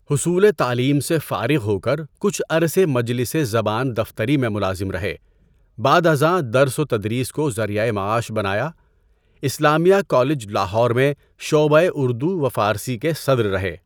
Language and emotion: Urdu, neutral